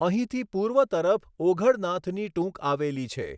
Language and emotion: Gujarati, neutral